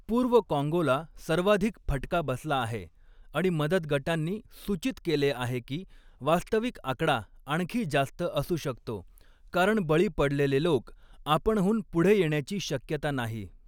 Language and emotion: Marathi, neutral